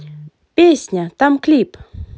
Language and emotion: Russian, positive